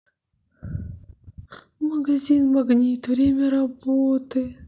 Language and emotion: Russian, sad